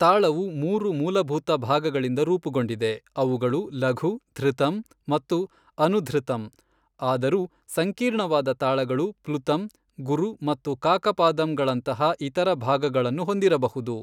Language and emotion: Kannada, neutral